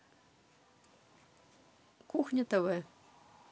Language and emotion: Russian, neutral